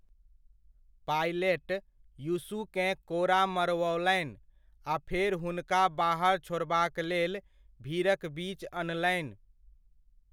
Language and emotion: Maithili, neutral